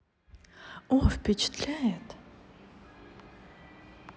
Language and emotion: Russian, positive